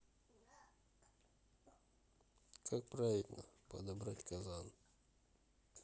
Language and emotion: Russian, neutral